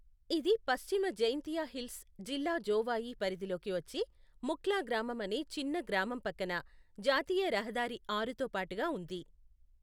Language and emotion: Telugu, neutral